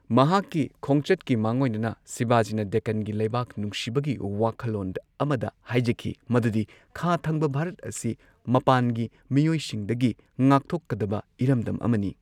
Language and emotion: Manipuri, neutral